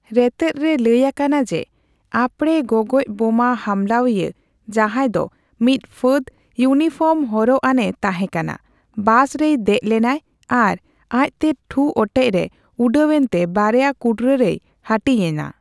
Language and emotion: Santali, neutral